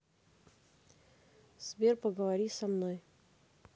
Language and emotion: Russian, neutral